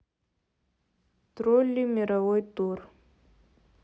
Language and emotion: Russian, neutral